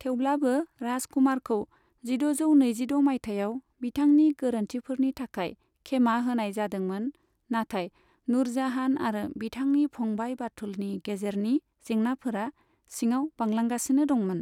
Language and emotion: Bodo, neutral